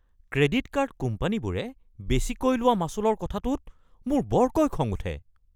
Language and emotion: Assamese, angry